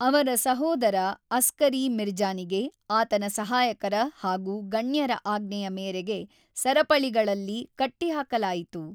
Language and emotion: Kannada, neutral